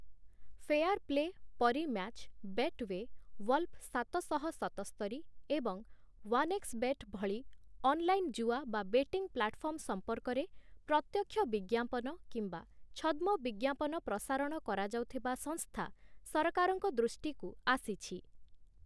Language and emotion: Odia, neutral